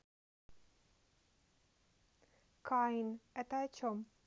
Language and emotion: Russian, neutral